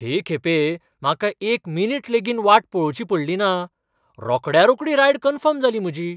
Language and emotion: Goan Konkani, surprised